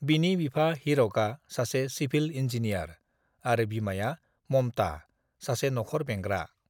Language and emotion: Bodo, neutral